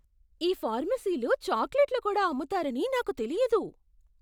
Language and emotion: Telugu, surprised